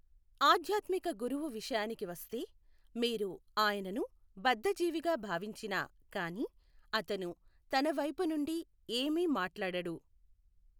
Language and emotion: Telugu, neutral